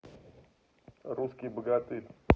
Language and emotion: Russian, neutral